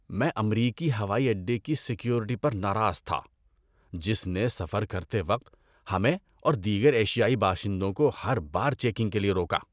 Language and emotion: Urdu, disgusted